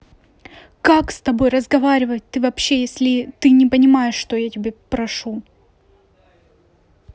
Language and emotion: Russian, angry